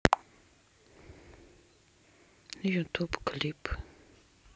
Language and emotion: Russian, neutral